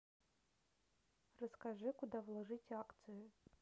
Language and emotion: Russian, neutral